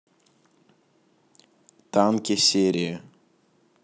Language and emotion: Russian, neutral